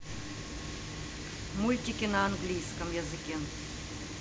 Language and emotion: Russian, neutral